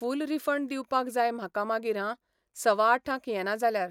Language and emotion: Goan Konkani, neutral